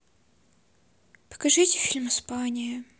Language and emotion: Russian, sad